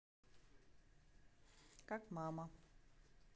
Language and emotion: Russian, neutral